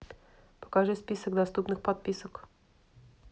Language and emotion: Russian, neutral